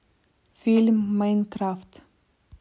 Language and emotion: Russian, neutral